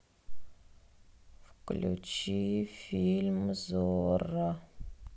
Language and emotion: Russian, sad